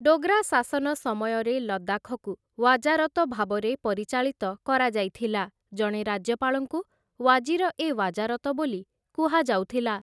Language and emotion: Odia, neutral